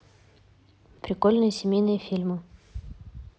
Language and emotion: Russian, neutral